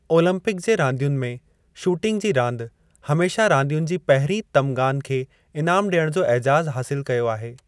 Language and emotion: Sindhi, neutral